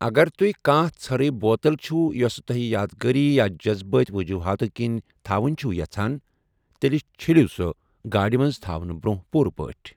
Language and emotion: Kashmiri, neutral